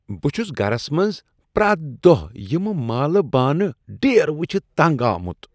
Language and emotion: Kashmiri, disgusted